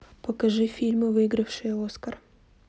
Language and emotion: Russian, neutral